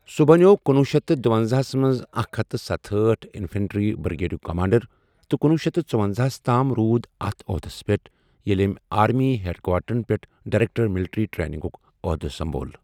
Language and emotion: Kashmiri, neutral